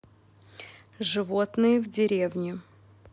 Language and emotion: Russian, neutral